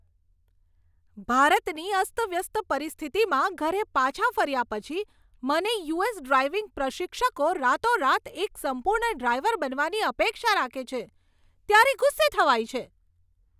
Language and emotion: Gujarati, angry